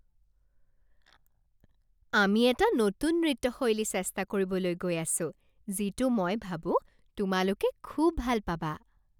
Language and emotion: Assamese, happy